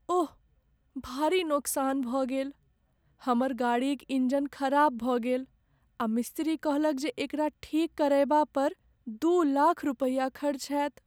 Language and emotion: Maithili, sad